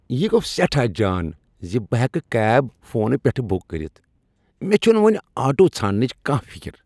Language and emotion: Kashmiri, happy